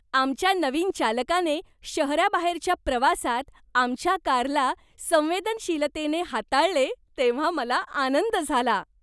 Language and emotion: Marathi, happy